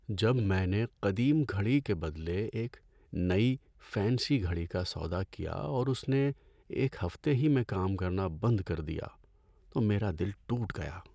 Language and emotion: Urdu, sad